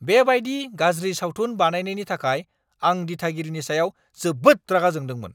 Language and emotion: Bodo, angry